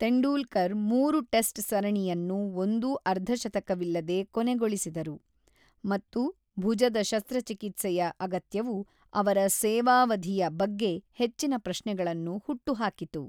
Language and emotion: Kannada, neutral